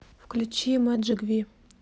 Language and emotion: Russian, neutral